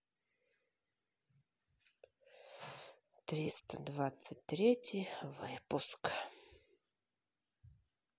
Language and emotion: Russian, sad